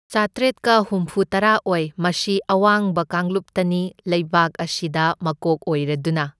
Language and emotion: Manipuri, neutral